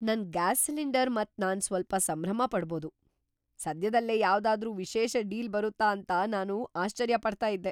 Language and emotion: Kannada, surprised